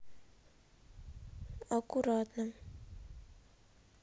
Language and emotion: Russian, sad